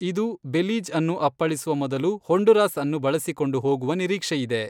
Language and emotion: Kannada, neutral